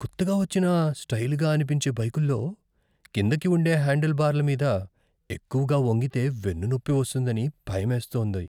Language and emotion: Telugu, fearful